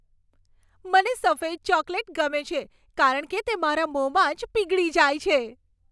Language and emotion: Gujarati, happy